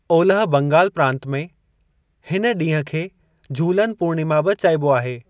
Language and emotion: Sindhi, neutral